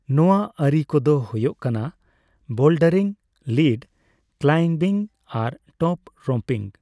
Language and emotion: Santali, neutral